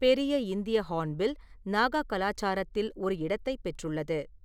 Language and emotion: Tamil, neutral